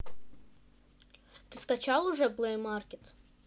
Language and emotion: Russian, neutral